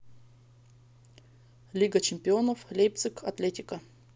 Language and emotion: Russian, neutral